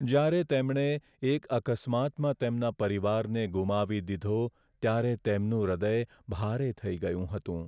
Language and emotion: Gujarati, sad